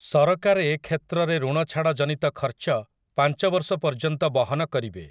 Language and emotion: Odia, neutral